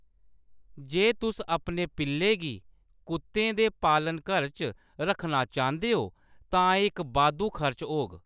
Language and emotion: Dogri, neutral